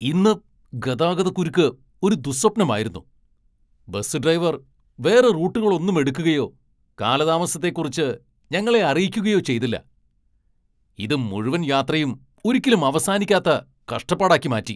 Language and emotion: Malayalam, angry